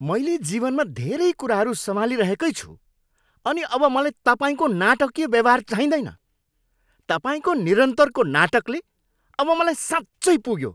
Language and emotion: Nepali, angry